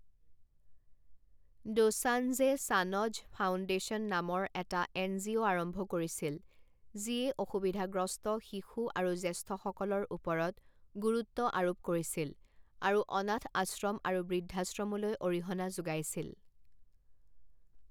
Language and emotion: Assamese, neutral